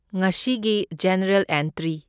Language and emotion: Manipuri, neutral